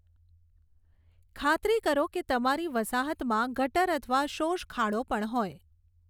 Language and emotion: Gujarati, neutral